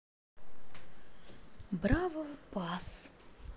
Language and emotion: Russian, neutral